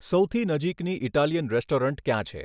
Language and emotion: Gujarati, neutral